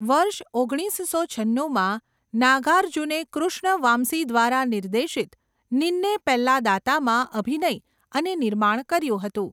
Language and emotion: Gujarati, neutral